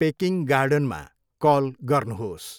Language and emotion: Nepali, neutral